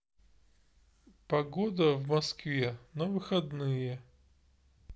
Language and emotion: Russian, neutral